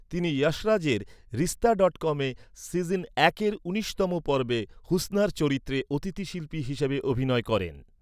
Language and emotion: Bengali, neutral